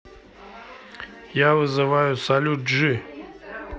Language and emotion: Russian, neutral